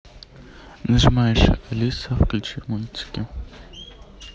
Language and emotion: Russian, neutral